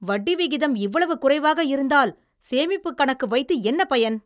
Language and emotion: Tamil, angry